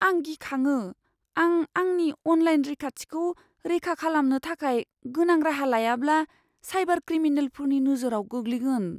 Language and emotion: Bodo, fearful